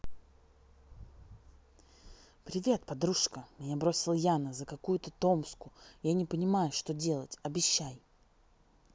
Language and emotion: Russian, neutral